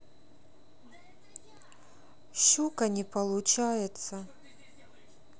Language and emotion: Russian, sad